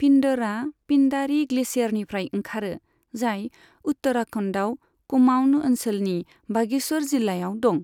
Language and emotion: Bodo, neutral